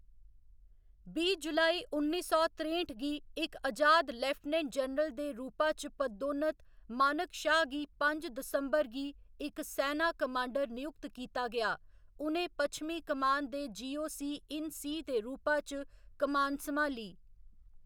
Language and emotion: Dogri, neutral